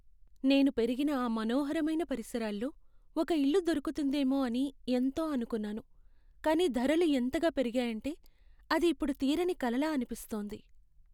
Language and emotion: Telugu, sad